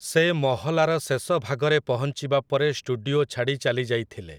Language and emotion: Odia, neutral